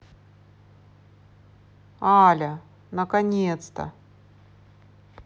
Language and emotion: Russian, positive